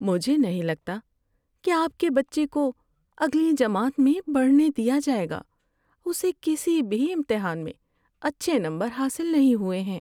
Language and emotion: Urdu, sad